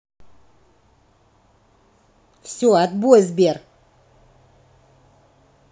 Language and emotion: Russian, angry